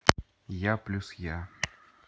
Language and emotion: Russian, neutral